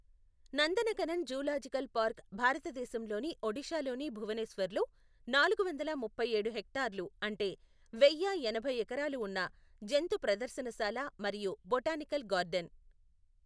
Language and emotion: Telugu, neutral